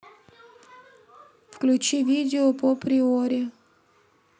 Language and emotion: Russian, neutral